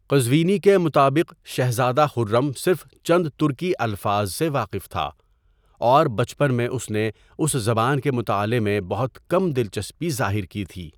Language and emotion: Urdu, neutral